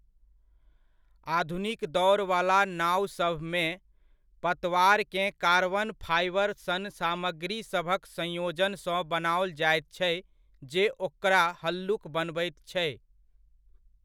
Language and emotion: Maithili, neutral